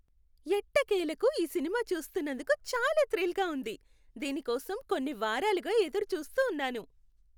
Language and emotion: Telugu, happy